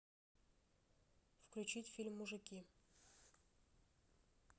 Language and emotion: Russian, neutral